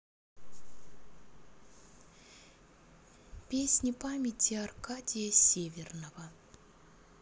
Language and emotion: Russian, neutral